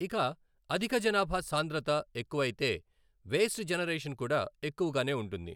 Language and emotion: Telugu, neutral